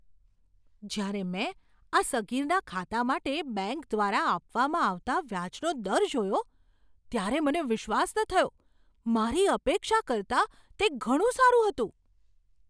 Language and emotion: Gujarati, surprised